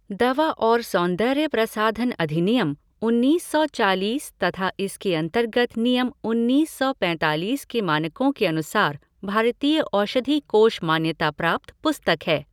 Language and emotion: Hindi, neutral